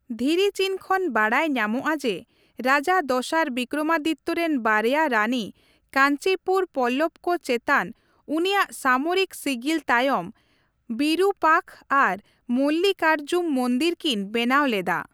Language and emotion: Santali, neutral